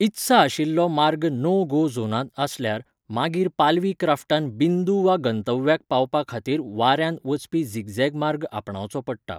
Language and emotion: Goan Konkani, neutral